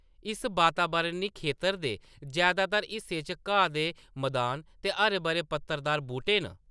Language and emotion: Dogri, neutral